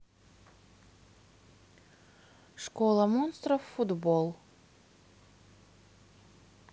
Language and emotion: Russian, neutral